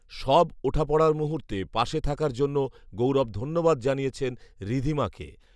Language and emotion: Bengali, neutral